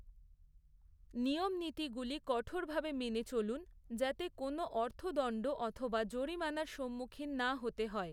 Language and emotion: Bengali, neutral